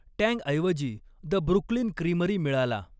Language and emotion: Marathi, neutral